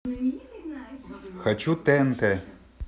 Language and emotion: Russian, neutral